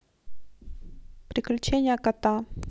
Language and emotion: Russian, neutral